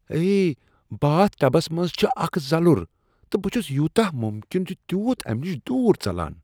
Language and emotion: Kashmiri, disgusted